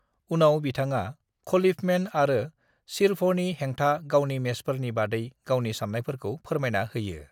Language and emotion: Bodo, neutral